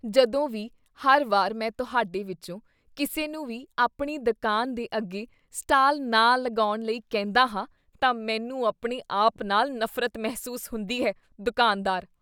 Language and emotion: Punjabi, disgusted